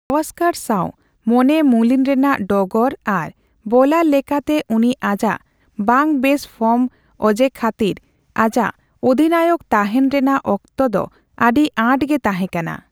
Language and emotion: Santali, neutral